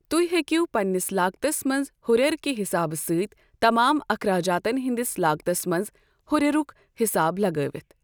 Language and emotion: Kashmiri, neutral